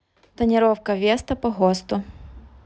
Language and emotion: Russian, neutral